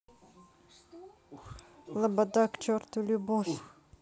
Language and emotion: Russian, sad